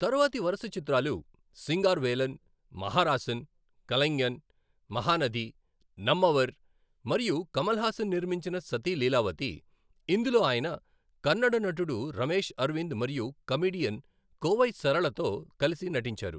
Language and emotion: Telugu, neutral